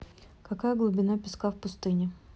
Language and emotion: Russian, neutral